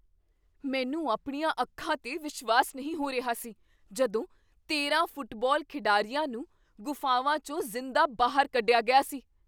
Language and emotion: Punjabi, surprised